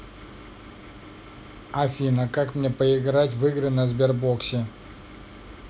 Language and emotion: Russian, neutral